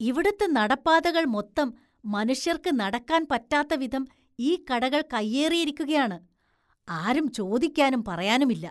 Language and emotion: Malayalam, disgusted